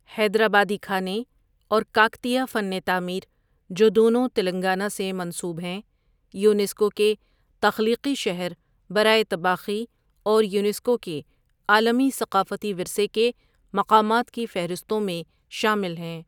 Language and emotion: Urdu, neutral